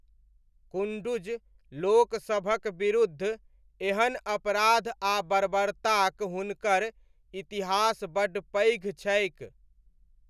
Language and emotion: Maithili, neutral